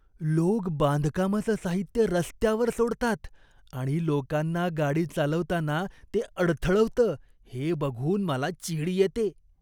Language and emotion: Marathi, disgusted